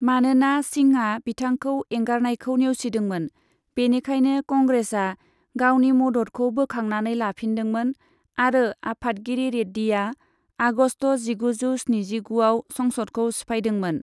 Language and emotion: Bodo, neutral